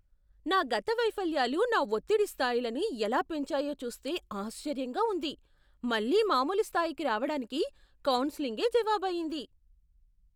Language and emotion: Telugu, surprised